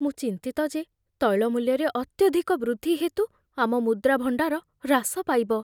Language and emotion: Odia, fearful